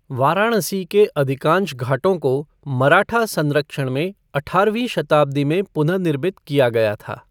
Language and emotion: Hindi, neutral